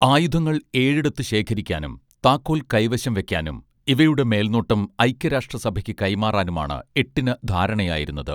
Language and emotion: Malayalam, neutral